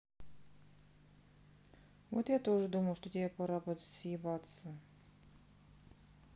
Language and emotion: Russian, sad